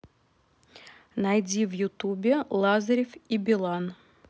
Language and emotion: Russian, neutral